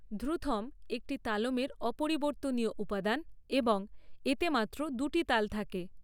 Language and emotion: Bengali, neutral